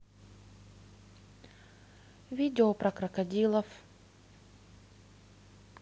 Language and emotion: Russian, neutral